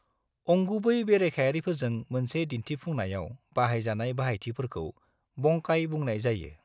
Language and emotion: Bodo, neutral